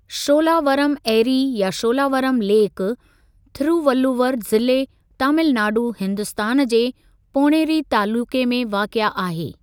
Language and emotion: Sindhi, neutral